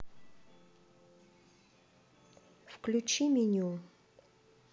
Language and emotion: Russian, neutral